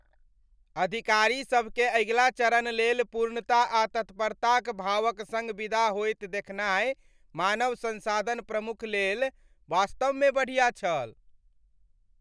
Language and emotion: Maithili, happy